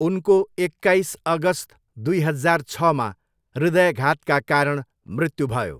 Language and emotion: Nepali, neutral